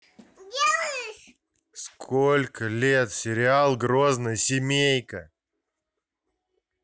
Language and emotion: Russian, angry